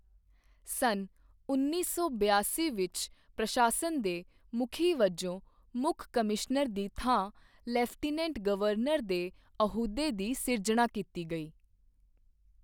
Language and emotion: Punjabi, neutral